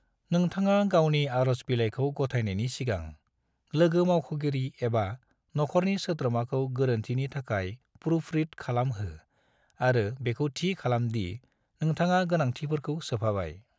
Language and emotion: Bodo, neutral